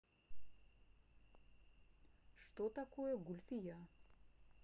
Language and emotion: Russian, neutral